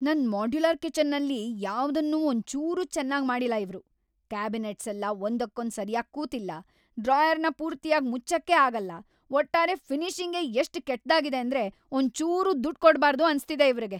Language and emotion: Kannada, angry